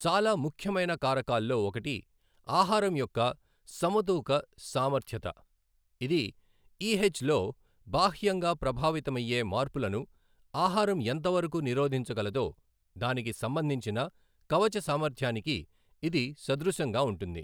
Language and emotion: Telugu, neutral